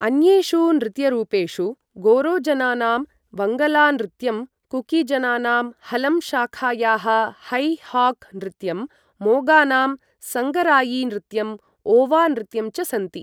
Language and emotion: Sanskrit, neutral